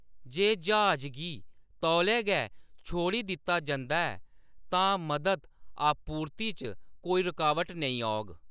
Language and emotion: Dogri, neutral